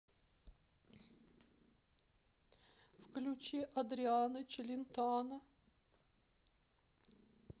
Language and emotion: Russian, sad